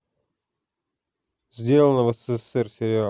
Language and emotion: Russian, neutral